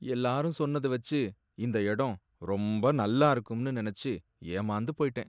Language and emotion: Tamil, sad